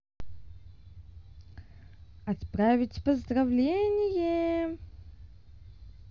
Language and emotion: Russian, positive